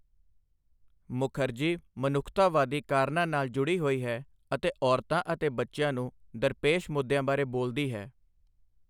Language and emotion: Punjabi, neutral